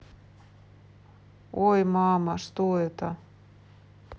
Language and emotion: Russian, neutral